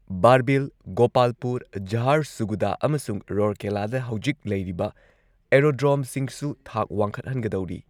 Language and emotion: Manipuri, neutral